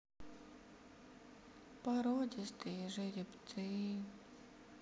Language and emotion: Russian, sad